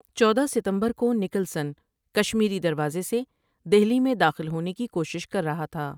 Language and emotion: Urdu, neutral